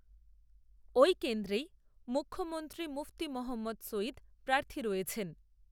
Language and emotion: Bengali, neutral